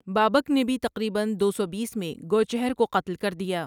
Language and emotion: Urdu, neutral